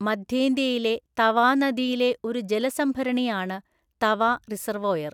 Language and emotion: Malayalam, neutral